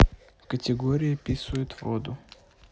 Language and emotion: Russian, neutral